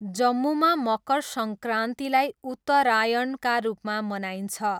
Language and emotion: Nepali, neutral